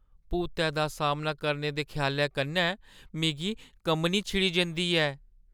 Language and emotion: Dogri, fearful